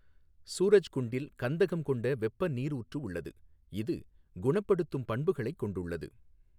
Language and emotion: Tamil, neutral